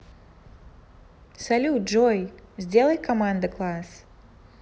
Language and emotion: Russian, positive